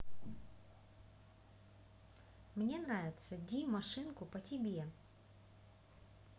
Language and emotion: Russian, neutral